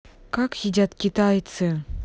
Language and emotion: Russian, angry